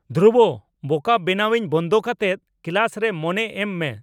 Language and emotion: Santali, angry